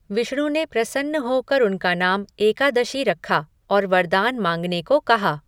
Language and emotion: Hindi, neutral